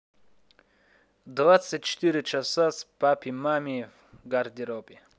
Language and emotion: Russian, neutral